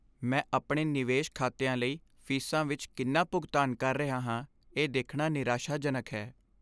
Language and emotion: Punjabi, sad